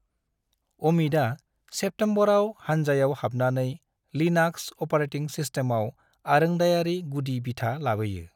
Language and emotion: Bodo, neutral